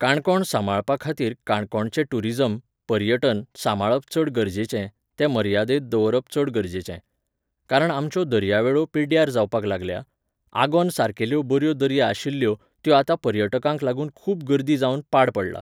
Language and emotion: Goan Konkani, neutral